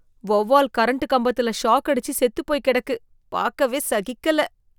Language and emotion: Tamil, disgusted